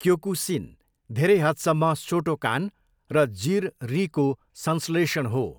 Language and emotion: Nepali, neutral